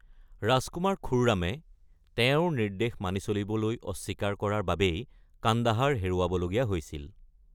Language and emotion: Assamese, neutral